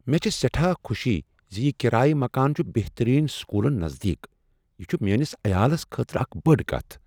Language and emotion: Kashmiri, surprised